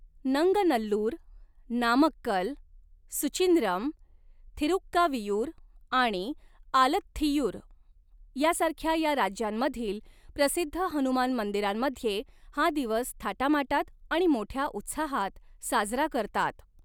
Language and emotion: Marathi, neutral